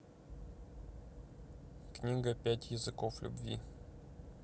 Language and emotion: Russian, neutral